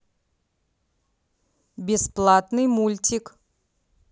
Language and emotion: Russian, neutral